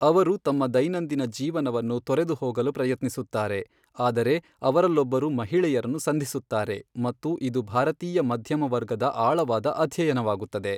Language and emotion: Kannada, neutral